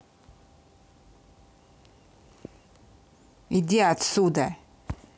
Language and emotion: Russian, angry